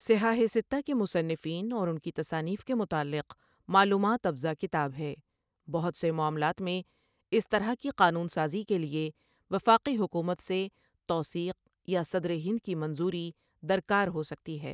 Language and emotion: Urdu, neutral